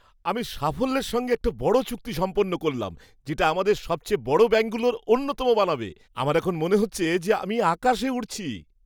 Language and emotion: Bengali, happy